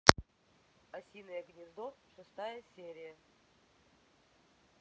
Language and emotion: Russian, neutral